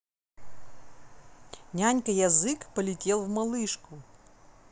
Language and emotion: Russian, neutral